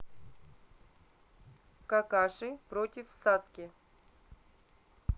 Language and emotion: Russian, neutral